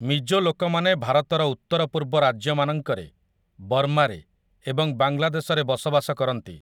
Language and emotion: Odia, neutral